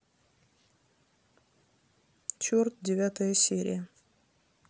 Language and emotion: Russian, neutral